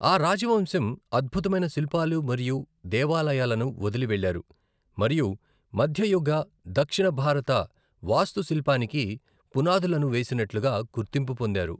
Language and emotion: Telugu, neutral